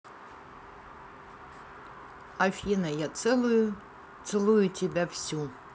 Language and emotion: Russian, neutral